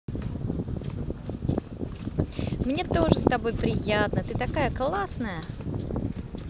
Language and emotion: Russian, positive